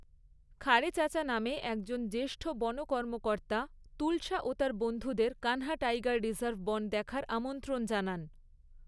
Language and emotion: Bengali, neutral